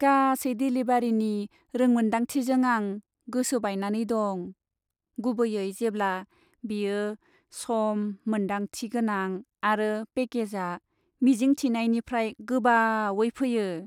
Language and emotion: Bodo, sad